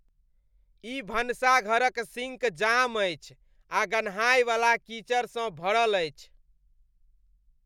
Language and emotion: Maithili, disgusted